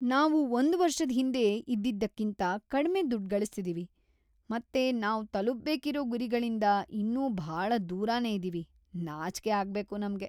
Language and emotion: Kannada, disgusted